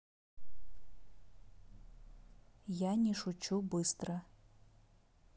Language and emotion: Russian, neutral